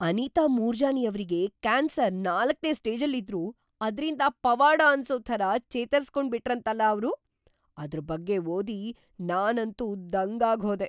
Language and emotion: Kannada, surprised